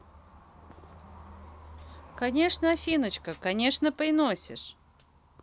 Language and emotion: Russian, positive